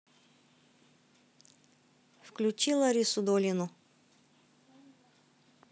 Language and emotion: Russian, neutral